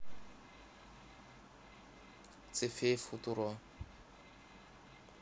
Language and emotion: Russian, neutral